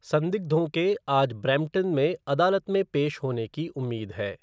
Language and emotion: Hindi, neutral